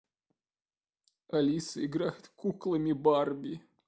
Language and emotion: Russian, sad